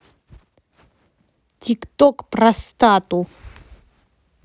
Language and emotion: Russian, angry